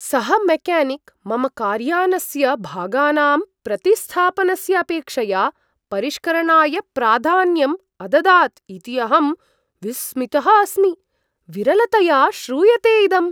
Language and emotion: Sanskrit, surprised